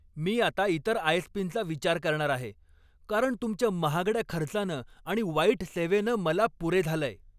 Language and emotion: Marathi, angry